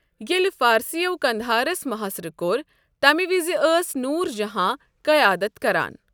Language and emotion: Kashmiri, neutral